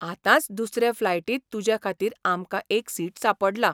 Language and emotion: Goan Konkani, surprised